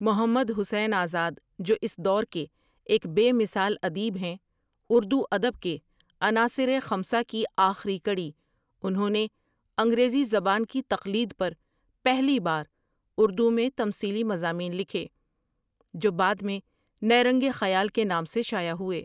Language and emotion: Urdu, neutral